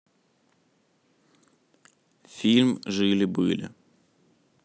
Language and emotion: Russian, neutral